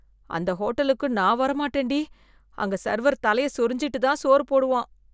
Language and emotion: Tamil, disgusted